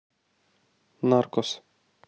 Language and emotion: Russian, neutral